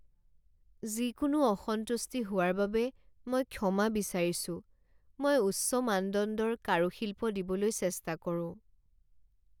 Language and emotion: Assamese, sad